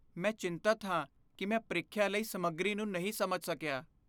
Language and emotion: Punjabi, fearful